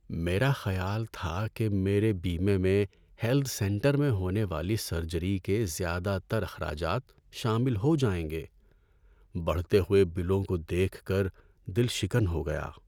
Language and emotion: Urdu, sad